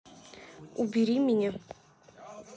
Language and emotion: Russian, neutral